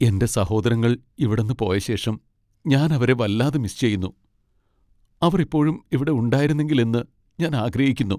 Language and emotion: Malayalam, sad